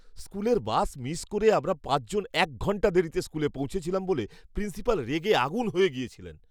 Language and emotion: Bengali, angry